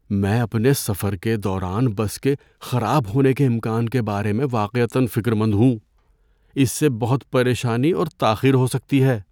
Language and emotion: Urdu, fearful